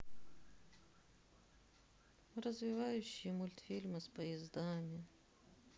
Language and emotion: Russian, sad